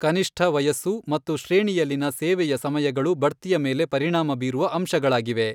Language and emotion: Kannada, neutral